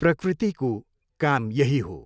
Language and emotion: Nepali, neutral